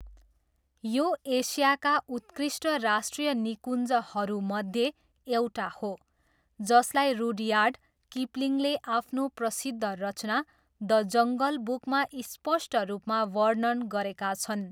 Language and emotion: Nepali, neutral